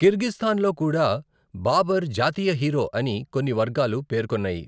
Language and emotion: Telugu, neutral